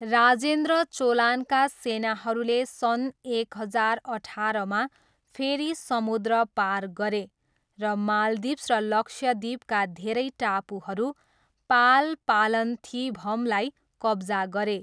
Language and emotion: Nepali, neutral